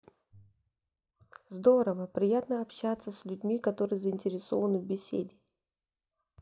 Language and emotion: Russian, neutral